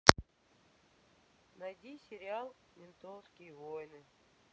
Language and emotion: Russian, sad